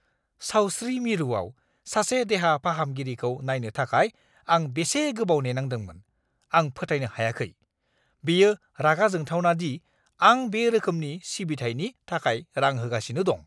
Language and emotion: Bodo, angry